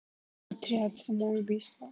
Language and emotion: Russian, neutral